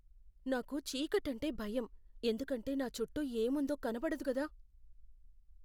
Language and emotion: Telugu, fearful